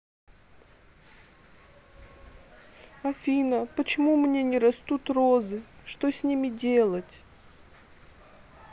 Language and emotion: Russian, sad